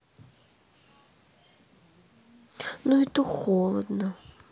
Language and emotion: Russian, sad